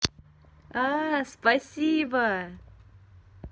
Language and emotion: Russian, positive